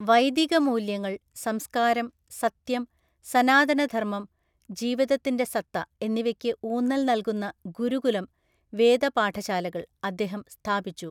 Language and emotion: Malayalam, neutral